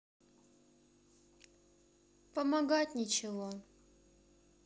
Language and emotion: Russian, sad